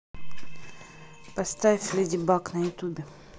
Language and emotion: Russian, neutral